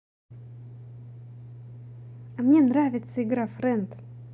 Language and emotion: Russian, positive